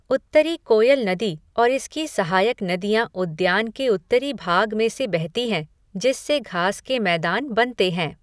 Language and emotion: Hindi, neutral